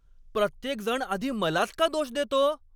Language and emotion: Marathi, angry